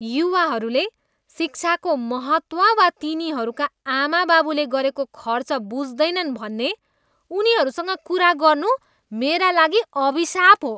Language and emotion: Nepali, disgusted